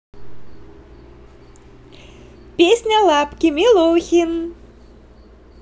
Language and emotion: Russian, positive